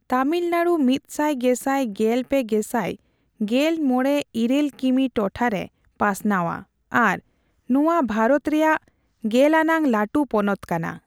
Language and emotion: Santali, neutral